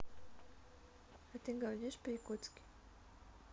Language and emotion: Russian, neutral